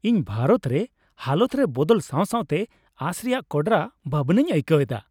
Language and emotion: Santali, happy